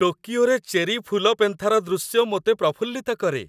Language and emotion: Odia, happy